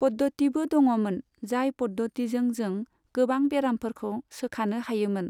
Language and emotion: Bodo, neutral